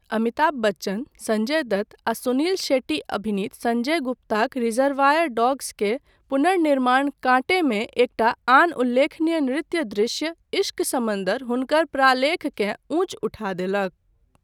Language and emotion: Maithili, neutral